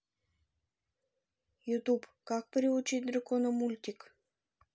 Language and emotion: Russian, neutral